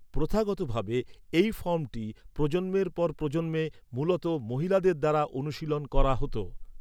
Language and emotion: Bengali, neutral